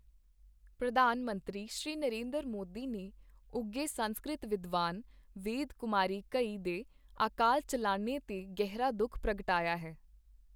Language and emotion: Punjabi, neutral